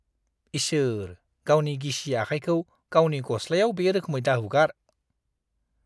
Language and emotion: Bodo, disgusted